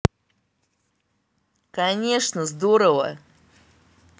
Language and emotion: Russian, positive